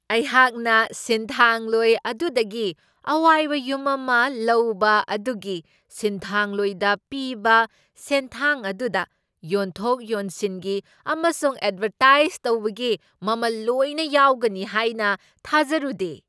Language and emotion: Manipuri, surprised